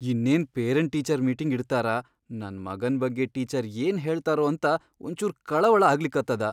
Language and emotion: Kannada, fearful